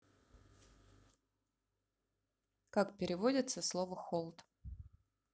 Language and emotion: Russian, neutral